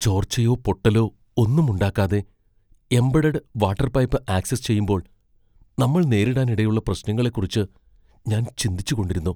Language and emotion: Malayalam, fearful